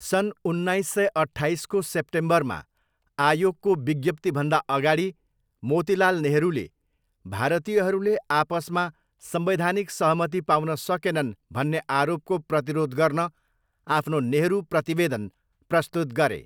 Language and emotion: Nepali, neutral